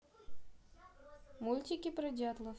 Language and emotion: Russian, neutral